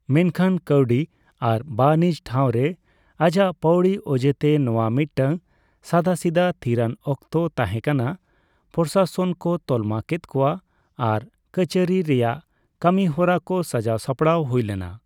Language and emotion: Santali, neutral